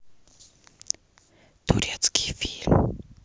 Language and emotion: Russian, neutral